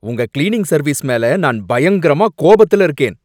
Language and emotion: Tamil, angry